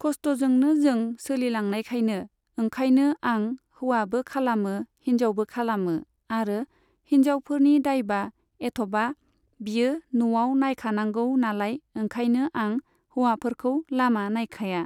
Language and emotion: Bodo, neutral